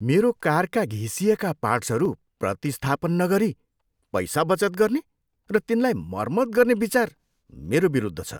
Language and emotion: Nepali, disgusted